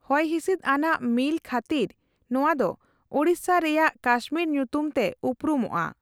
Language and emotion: Santali, neutral